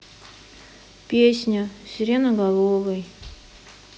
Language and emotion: Russian, sad